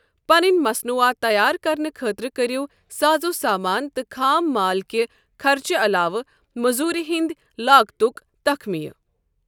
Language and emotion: Kashmiri, neutral